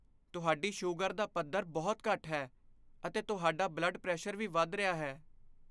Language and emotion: Punjabi, fearful